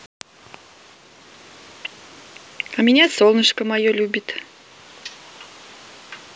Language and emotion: Russian, positive